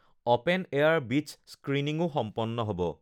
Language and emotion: Assamese, neutral